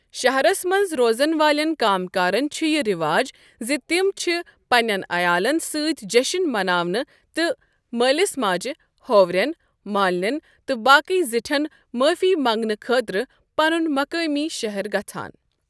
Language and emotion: Kashmiri, neutral